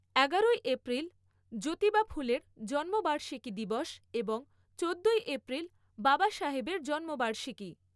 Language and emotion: Bengali, neutral